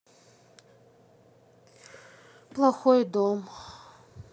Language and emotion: Russian, sad